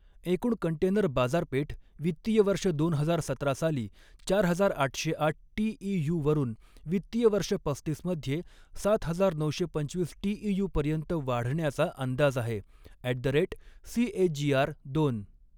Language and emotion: Marathi, neutral